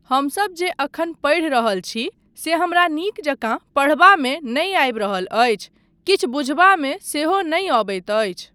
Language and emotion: Maithili, neutral